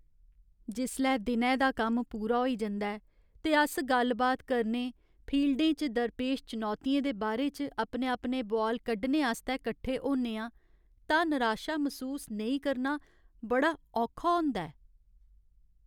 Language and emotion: Dogri, sad